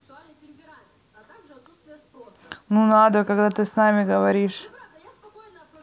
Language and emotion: Russian, neutral